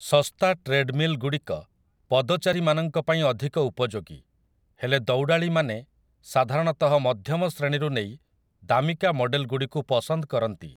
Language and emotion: Odia, neutral